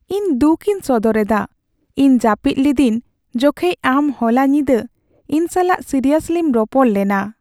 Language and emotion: Santali, sad